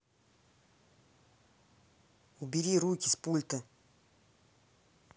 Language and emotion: Russian, angry